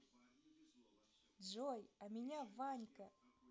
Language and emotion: Russian, positive